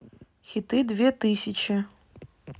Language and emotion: Russian, neutral